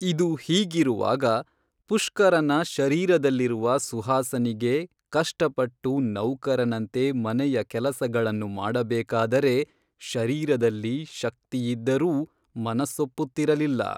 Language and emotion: Kannada, neutral